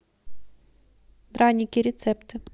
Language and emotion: Russian, neutral